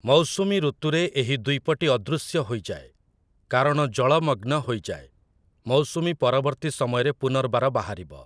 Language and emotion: Odia, neutral